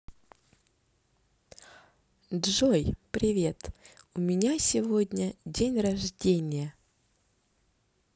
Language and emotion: Russian, positive